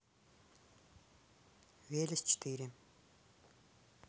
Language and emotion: Russian, neutral